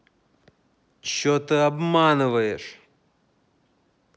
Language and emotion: Russian, angry